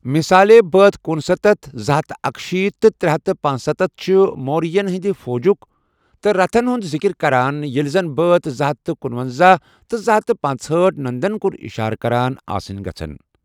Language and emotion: Kashmiri, neutral